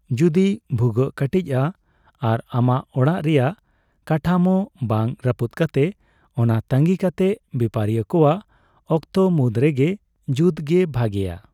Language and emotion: Santali, neutral